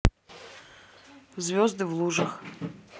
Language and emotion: Russian, neutral